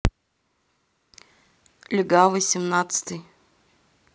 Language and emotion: Russian, neutral